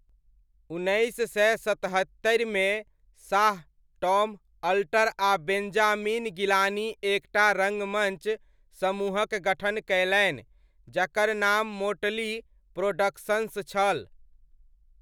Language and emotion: Maithili, neutral